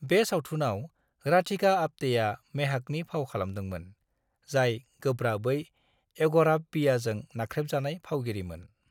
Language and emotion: Bodo, neutral